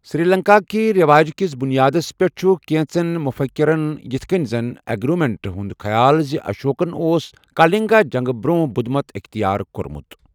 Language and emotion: Kashmiri, neutral